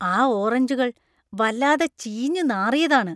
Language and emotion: Malayalam, disgusted